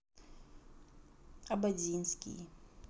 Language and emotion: Russian, neutral